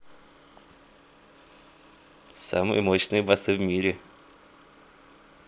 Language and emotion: Russian, positive